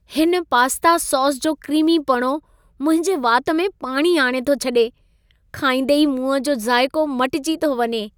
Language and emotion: Sindhi, happy